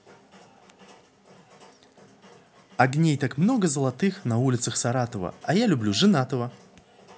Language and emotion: Russian, positive